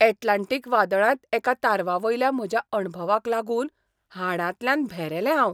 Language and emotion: Goan Konkani, surprised